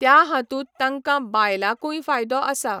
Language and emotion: Goan Konkani, neutral